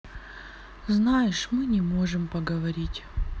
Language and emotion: Russian, sad